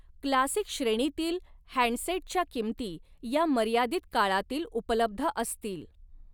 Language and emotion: Marathi, neutral